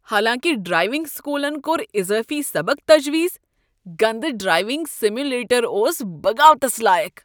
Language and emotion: Kashmiri, disgusted